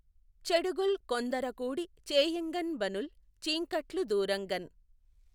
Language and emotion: Telugu, neutral